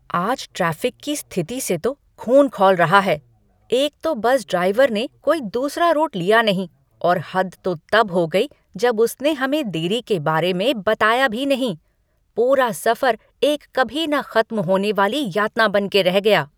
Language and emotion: Hindi, angry